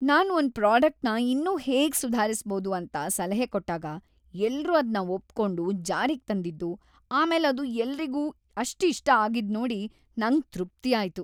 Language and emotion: Kannada, happy